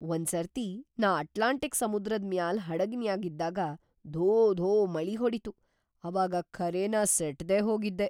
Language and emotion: Kannada, surprised